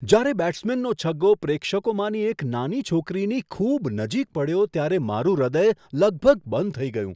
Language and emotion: Gujarati, surprised